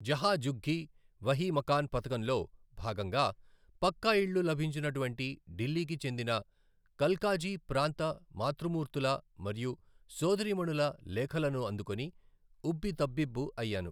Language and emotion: Telugu, neutral